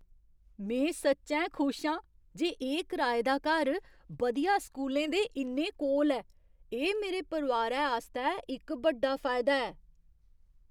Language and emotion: Dogri, surprised